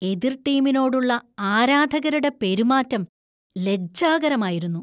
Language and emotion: Malayalam, disgusted